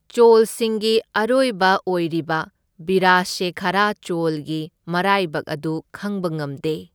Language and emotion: Manipuri, neutral